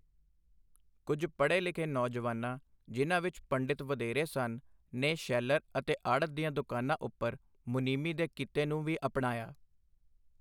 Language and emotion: Punjabi, neutral